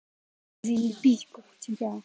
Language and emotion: Russian, angry